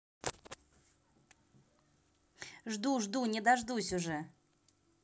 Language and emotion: Russian, positive